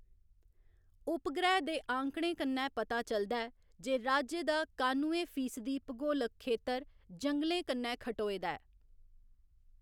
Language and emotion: Dogri, neutral